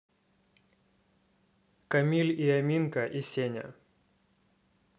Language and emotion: Russian, neutral